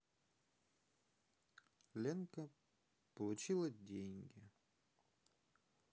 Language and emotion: Russian, sad